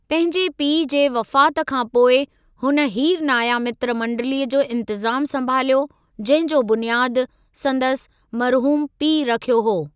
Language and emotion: Sindhi, neutral